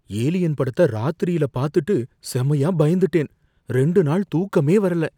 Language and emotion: Tamil, fearful